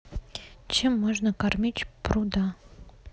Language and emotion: Russian, neutral